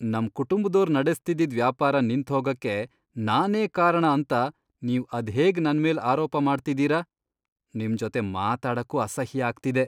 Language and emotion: Kannada, disgusted